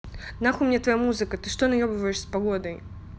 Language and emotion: Russian, angry